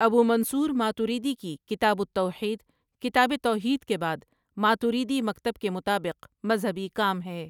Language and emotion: Urdu, neutral